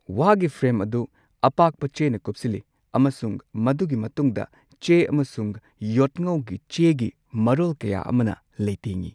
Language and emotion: Manipuri, neutral